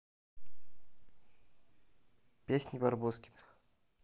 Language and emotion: Russian, neutral